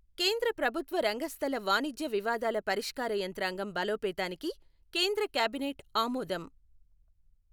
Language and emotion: Telugu, neutral